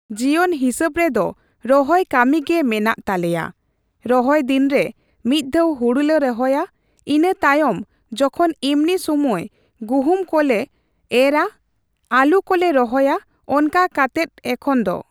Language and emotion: Santali, neutral